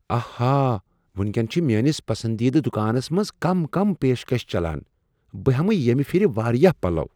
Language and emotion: Kashmiri, surprised